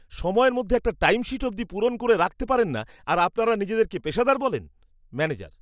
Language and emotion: Bengali, disgusted